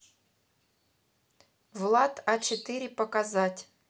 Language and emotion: Russian, neutral